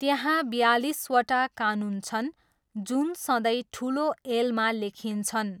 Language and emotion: Nepali, neutral